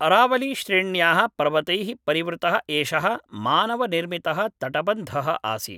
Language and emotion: Sanskrit, neutral